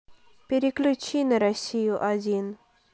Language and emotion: Russian, neutral